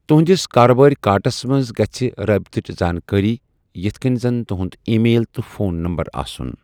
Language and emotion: Kashmiri, neutral